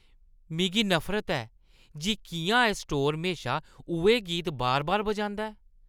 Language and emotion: Dogri, disgusted